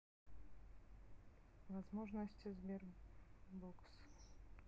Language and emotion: Russian, neutral